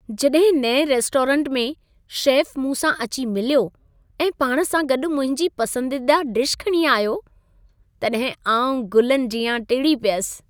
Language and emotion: Sindhi, happy